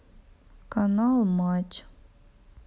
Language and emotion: Russian, sad